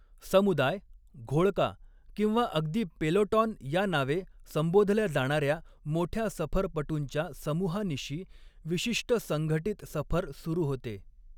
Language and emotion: Marathi, neutral